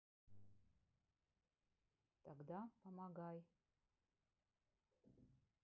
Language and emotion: Russian, neutral